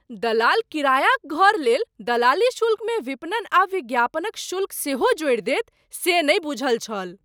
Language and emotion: Maithili, surprised